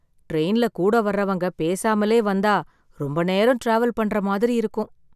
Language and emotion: Tamil, sad